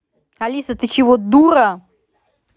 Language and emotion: Russian, angry